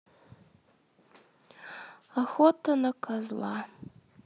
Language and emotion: Russian, sad